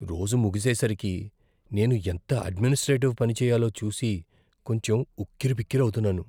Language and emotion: Telugu, fearful